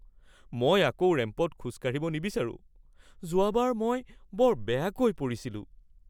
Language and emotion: Assamese, fearful